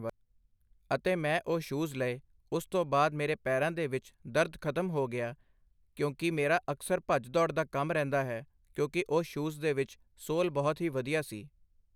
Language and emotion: Punjabi, neutral